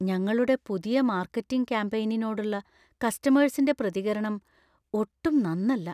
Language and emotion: Malayalam, fearful